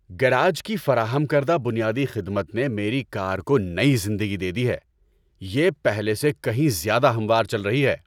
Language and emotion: Urdu, happy